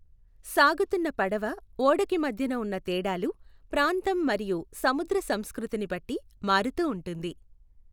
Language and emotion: Telugu, neutral